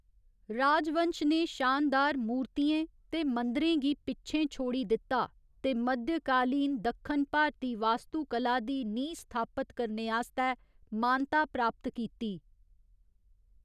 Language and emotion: Dogri, neutral